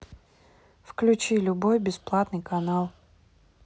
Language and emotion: Russian, neutral